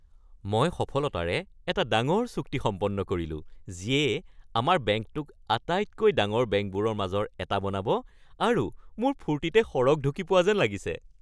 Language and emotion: Assamese, happy